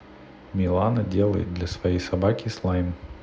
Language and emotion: Russian, neutral